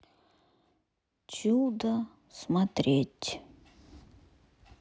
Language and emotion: Russian, sad